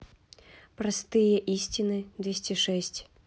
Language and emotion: Russian, neutral